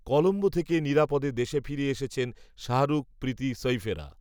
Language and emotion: Bengali, neutral